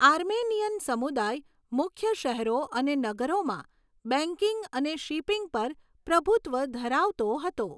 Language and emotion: Gujarati, neutral